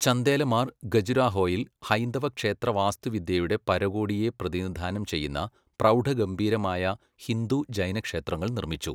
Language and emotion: Malayalam, neutral